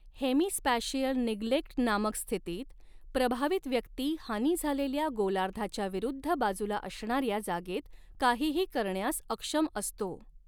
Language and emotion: Marathi, neutral